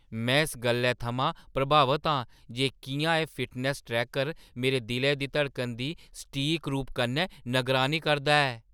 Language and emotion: Dogri, surprised